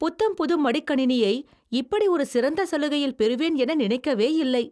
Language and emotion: Tamil, surprised